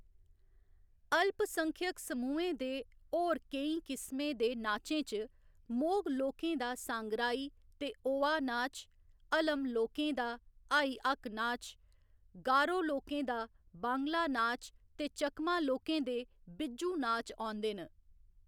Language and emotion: Dogri, neutral